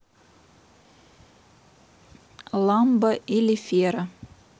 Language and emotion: Russian, neutral